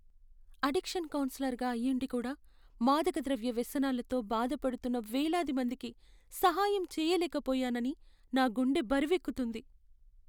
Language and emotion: Telugu, sad